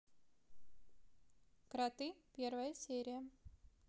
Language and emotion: Russian, neutral